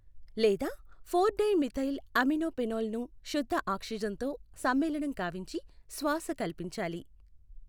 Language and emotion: Telugu, neutral